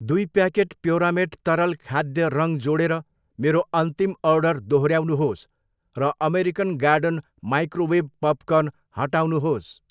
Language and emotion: Nepali, neutral